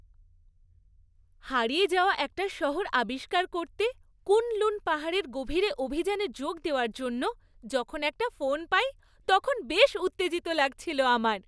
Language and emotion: Bengali, happy